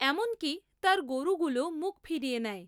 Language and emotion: Bengali, neutral